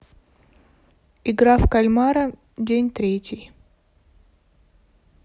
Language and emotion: Russian, neutral